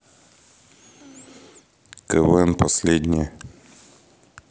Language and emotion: Russian, neutral